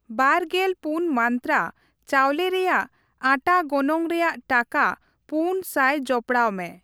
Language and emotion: Santali, neutral